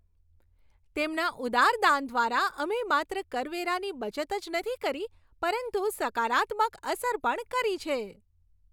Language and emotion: Gujarati, happy